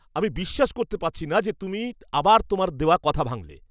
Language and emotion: Bengali, angry